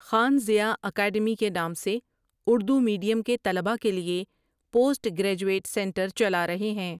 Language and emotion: Urdu, neutral